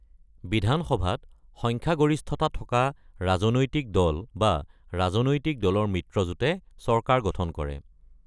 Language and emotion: Assamese, neutral